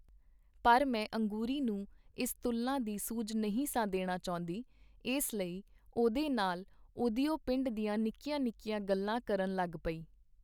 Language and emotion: Punjabi, neutral